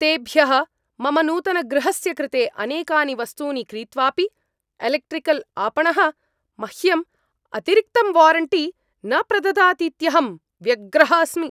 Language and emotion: Sanskrit, angry